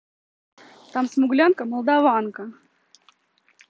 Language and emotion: Russian, neutral